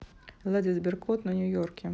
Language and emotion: Russian, neutral